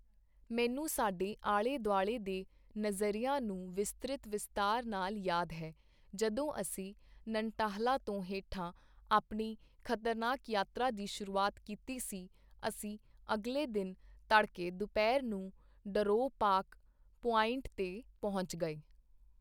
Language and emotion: Punjabi, neutral